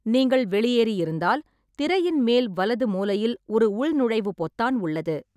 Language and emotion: Tamil, neutral